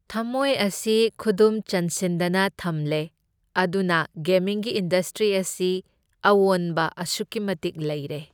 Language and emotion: Manipuri, neutral